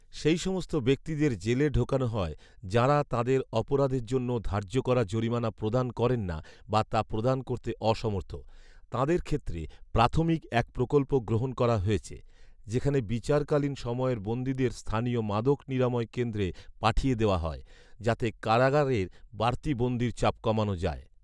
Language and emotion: Bengali, neutral